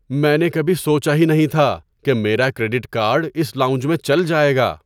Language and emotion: Urdu, surprised